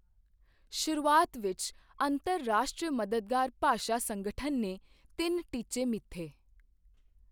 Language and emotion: Punjabi, neutral